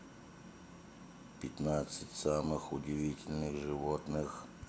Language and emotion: Russian, neutral